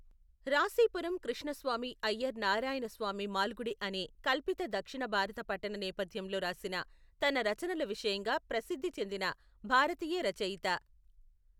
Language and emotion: Telugu, neutral